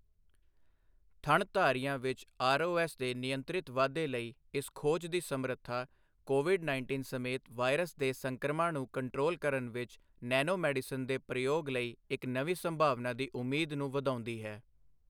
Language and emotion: Punjabi, neutral